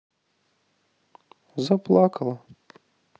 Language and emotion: Russian, sad